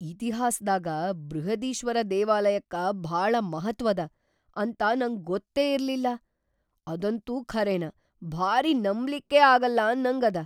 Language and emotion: Kannada, surprised